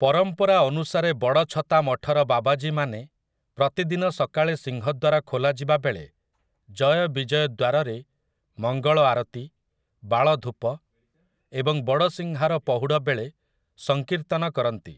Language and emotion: Odia, neutral